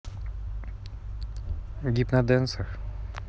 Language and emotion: Russian, neutral